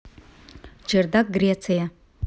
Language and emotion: Russian, neutral